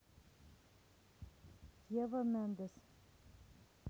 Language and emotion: Russian, neutral